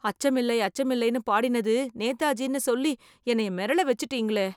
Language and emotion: Tamil, fearful